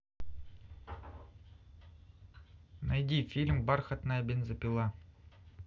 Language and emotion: Russian, neutral